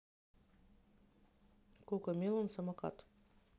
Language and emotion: Russian, neutral